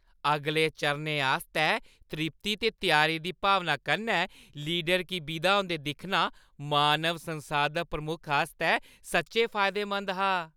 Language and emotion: Dogri, happy